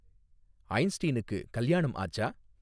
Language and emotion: Tamil, neutral